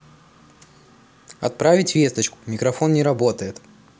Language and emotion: Russian, neutral